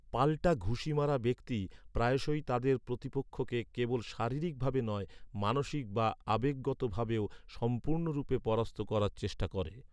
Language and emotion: Bengali, neutral